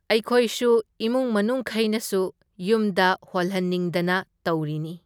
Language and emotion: Manipuri, neutral